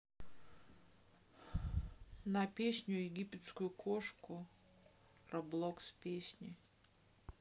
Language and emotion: Russian, neutral